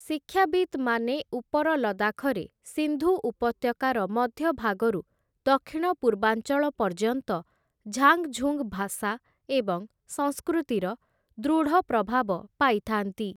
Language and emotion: Odia, neutral